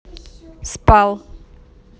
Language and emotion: Russian, neutral